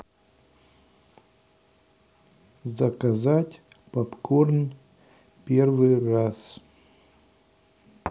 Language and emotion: Russian, neutral